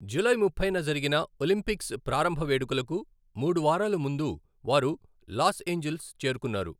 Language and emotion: Telugu, neutral